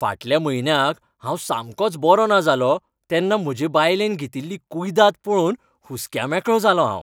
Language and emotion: Goan Konkani, happy